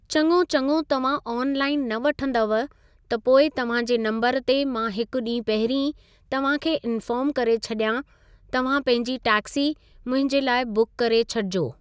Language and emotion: Sindhi, neutral